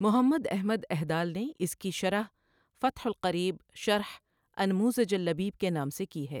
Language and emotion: Urdu, neutral